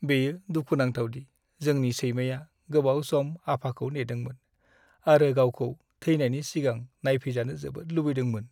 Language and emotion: Bodo, sad